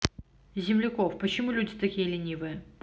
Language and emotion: Russian, neutral